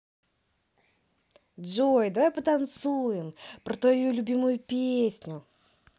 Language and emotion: Russian, positive